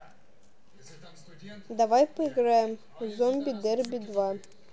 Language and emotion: Russian, neutral